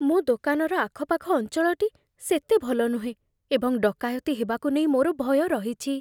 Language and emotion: Odia, fearful